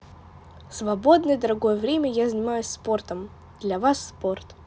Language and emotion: Russian, positive